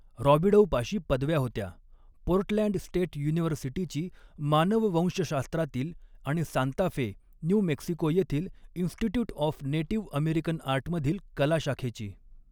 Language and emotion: Marathi, neutral